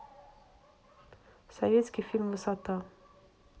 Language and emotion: Russian, neutral